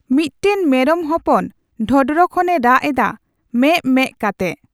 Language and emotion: Santali, neutral